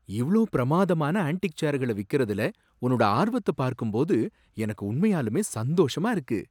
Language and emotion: Tamil, surprised